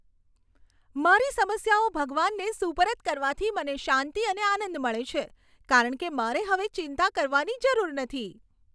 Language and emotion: Gujarati, happy